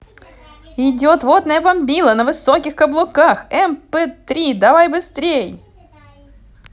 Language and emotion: Russian, positive